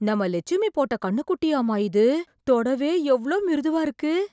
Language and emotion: Tamil, surprised